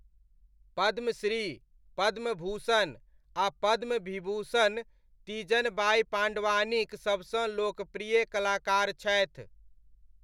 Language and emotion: Maithili, neutral